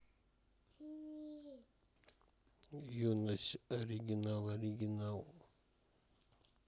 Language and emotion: Russian, neutral